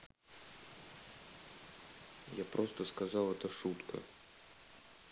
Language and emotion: Russian, neutral